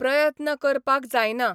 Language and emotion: Goan Konkani, neutral